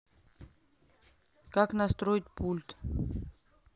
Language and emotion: Russian, neutral